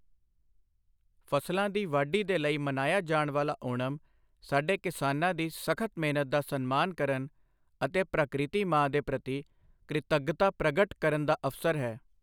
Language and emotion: Punjabi, neutral